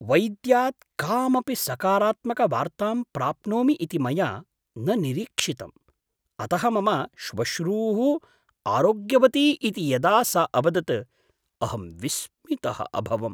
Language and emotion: Sanskrit, surprised